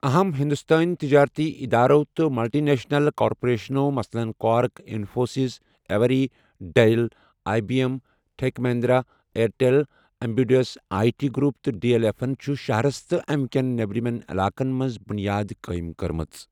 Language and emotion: Kashmiri, neutral